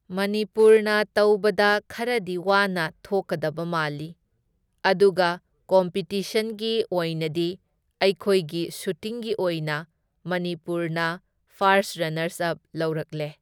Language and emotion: Manipuri, neutral